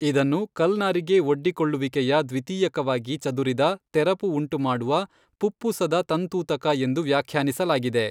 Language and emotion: Kannada, neutral